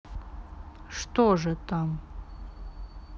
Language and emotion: Russian, neutral